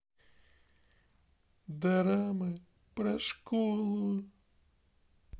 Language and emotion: Russian, sad